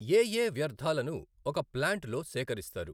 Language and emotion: Telugu, neutral